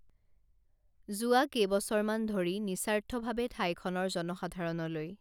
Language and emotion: Assamese, neutral